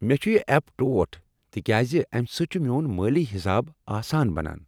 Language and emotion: Kashmiri, happy